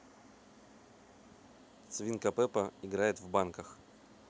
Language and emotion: Russian, neutral